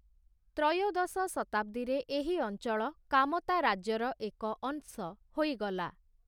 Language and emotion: Odia, neutral